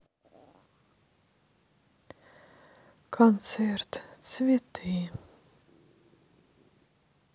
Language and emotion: Russian, sad